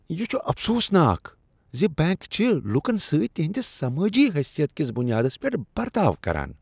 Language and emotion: Kashmiri, disgusted